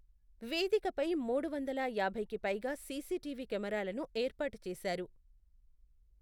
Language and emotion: Telugu, neutral